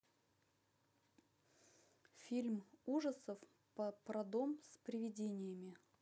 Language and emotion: Russian, neutral